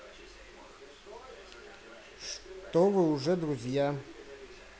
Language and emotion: Russian, neutral